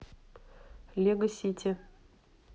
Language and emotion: Russian, neutral